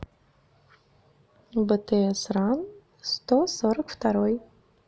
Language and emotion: Russian, neutral